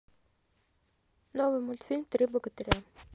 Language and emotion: Russian, neutral